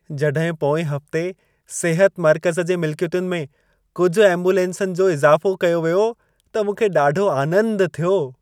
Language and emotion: Sindhi, happy